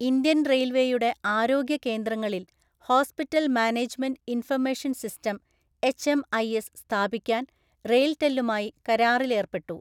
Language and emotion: Malayalam, neutral